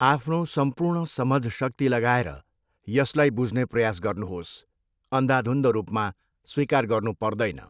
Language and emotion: Nepali, neutral